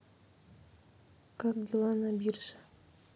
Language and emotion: Russian, neutral